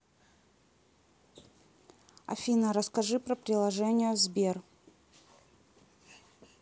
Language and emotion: Russian, neutral